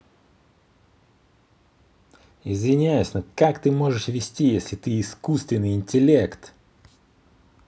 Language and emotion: Russian, angry